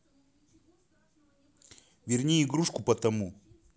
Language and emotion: Russian, angry